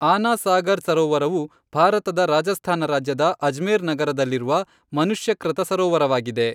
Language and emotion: Kannada, neutral